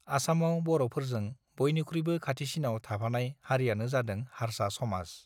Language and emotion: Bodo, neutral